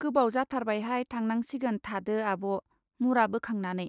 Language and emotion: Bodo, neutral